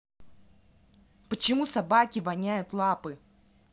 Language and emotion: Russian, angry